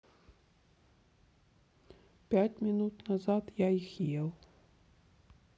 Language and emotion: Russian, sad